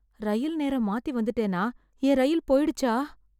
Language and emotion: Tamil, fearful